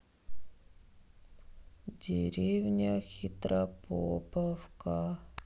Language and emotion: Russian, sad